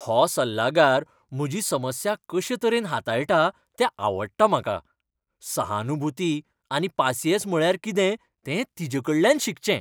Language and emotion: Goan Konkani, happy